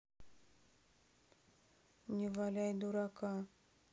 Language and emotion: Russian, neutral